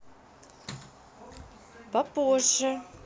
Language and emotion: Russian, neutral